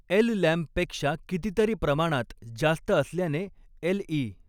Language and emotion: Marathi, neutral